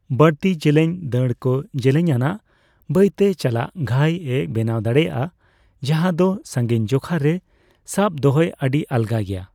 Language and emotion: Santali, neutral